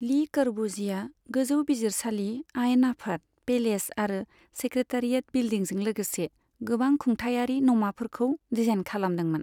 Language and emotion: Bodo, neutral